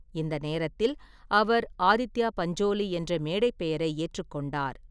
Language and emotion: Tamil, neutral